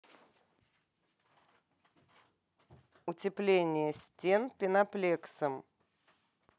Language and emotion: Russian, neutral